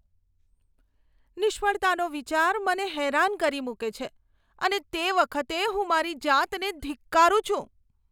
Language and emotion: Gujarati, disgusted